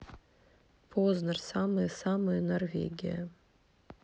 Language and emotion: Russian, neutral